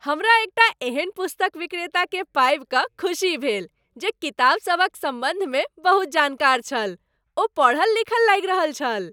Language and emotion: Maithili, happy